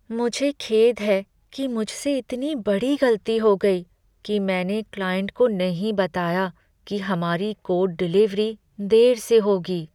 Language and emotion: Hindi, sad